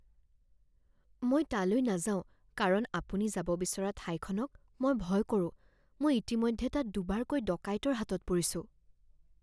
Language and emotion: Assamese, fearful